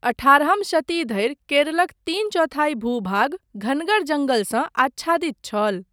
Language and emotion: Maithili, neutral